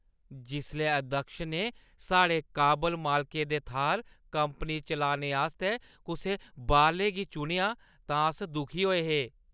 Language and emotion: Dogri, disgusted